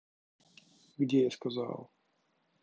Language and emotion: Russian, neutral